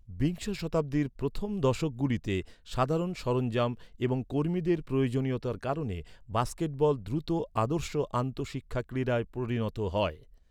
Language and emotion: Bengali, neutral